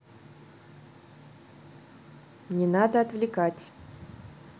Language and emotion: Russian, neutral